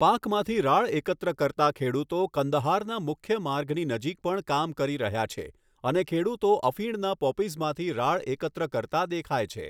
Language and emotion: Gujarati, neutral